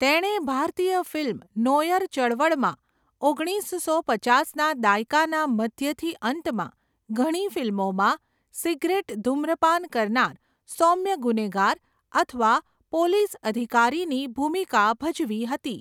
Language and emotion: Gujarati, neutral